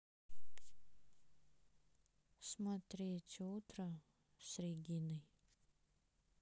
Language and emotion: Russian, sad